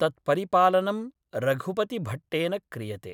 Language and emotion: Sanskrit, neutral